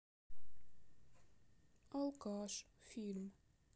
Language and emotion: Russian, sad